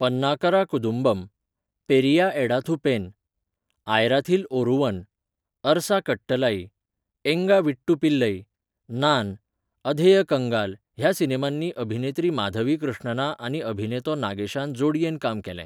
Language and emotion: Goan Konkani, neutral